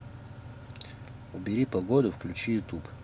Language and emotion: Russian, neutral